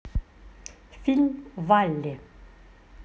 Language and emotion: Russian, neutral